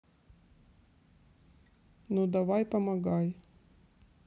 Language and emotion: Russian, neutral